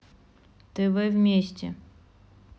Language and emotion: Russian, neutral